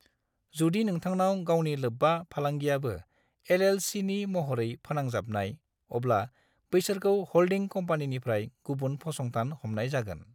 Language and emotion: Bodo, neutral